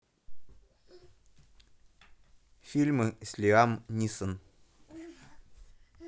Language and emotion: Russian, neutral